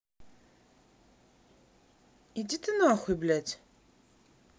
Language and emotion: Russian, angry